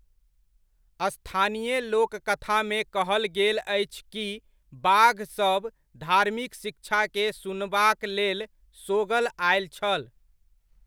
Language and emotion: Maithili, neutral